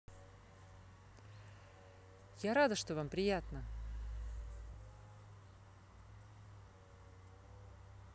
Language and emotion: Russian, neutral